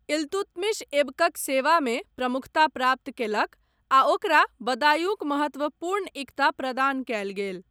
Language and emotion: Maithili, neutral